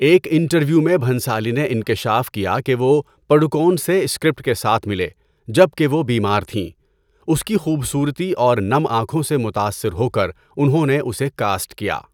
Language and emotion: Urdu, neutral